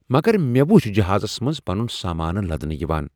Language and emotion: Kashmiri, surprised